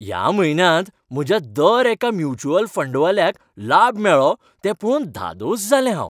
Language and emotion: Goan Konkani, happy